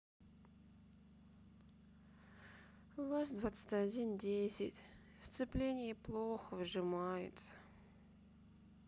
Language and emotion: Russian, sad